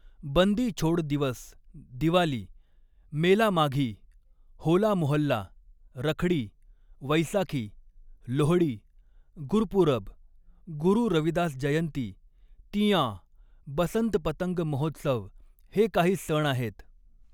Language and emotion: Marathi, neutral